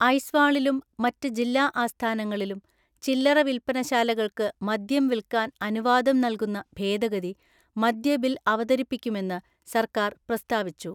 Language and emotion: Malayalam, neutral